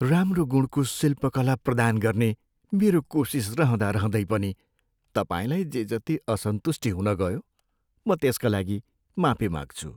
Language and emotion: Nepali, sad